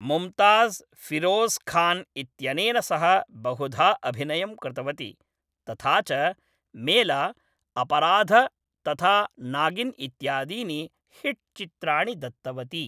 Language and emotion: Sanskrit, neutral